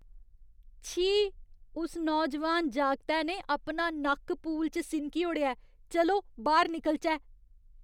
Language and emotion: Dogri, disgusted